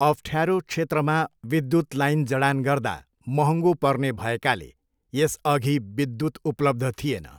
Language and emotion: Nepali, neutral